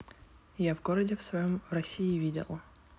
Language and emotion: Russian, neutral